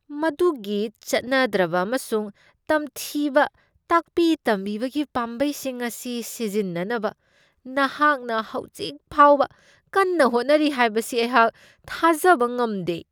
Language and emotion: Manipuri, disgusted